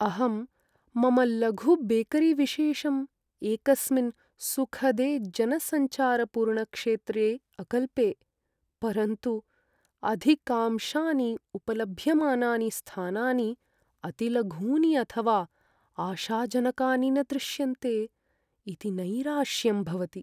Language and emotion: Sanskrit, sad